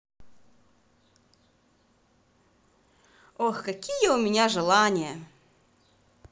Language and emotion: Russian, positive